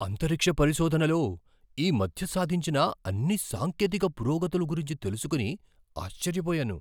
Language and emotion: Telugu, surprised